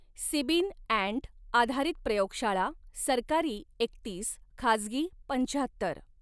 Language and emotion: Marathi, neutral